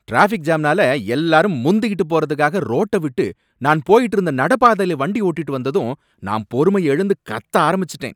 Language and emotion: Tamil, angry